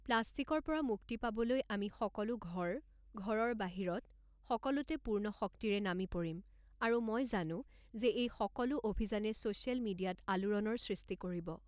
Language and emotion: Assamese, neutral